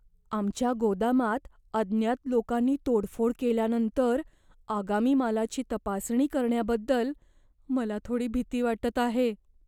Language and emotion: Marathi, fearful